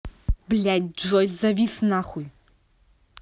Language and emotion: Russian, angry